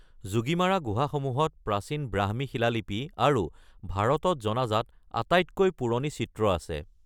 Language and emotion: Assamese, neutral